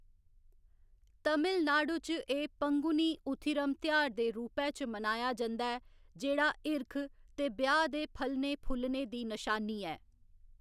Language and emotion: Dogri, neutral